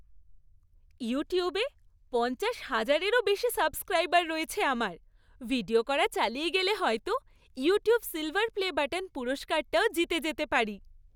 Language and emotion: Bengali, happy